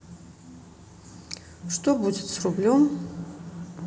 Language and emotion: Russian, neutral